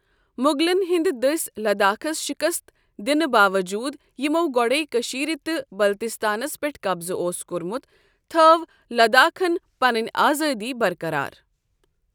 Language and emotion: Kashmiri, neutral